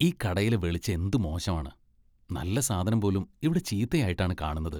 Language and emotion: Malayalam, disgusted